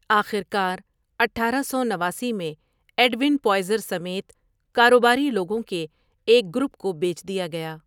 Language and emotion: Urdu, neutral